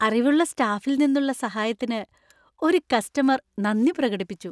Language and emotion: Malayalam, happy